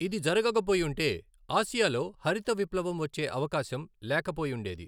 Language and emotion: Telugu, neutral